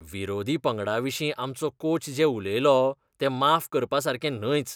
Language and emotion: Goan Konkani, disgusted